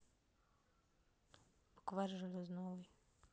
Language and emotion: Russian, neutral